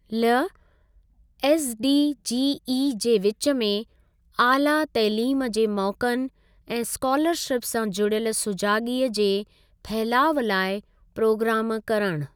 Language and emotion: Sindhi, neutral